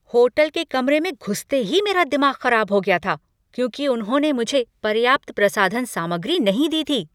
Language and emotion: Hindi, angry